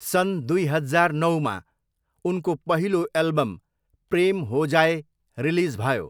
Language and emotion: Nepali, neutral